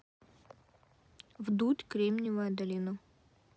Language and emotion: Russian, neutral